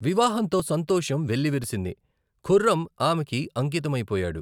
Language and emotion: Telugu, neutral